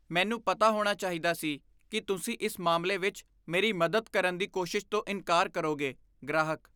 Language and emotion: Punjabi, disgusted